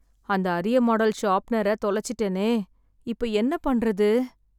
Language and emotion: Tamil, sad